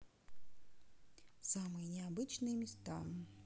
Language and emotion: Russian, neutral